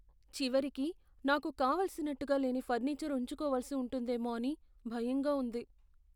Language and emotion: Telugu, fearful